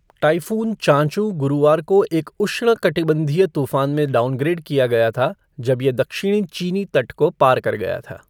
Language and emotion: Hindi, neutral